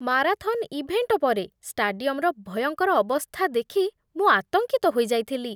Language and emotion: Odia, disgusted